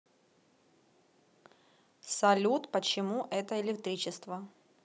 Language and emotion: Russian, neutral